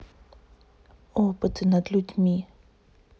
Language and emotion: Russian, neutral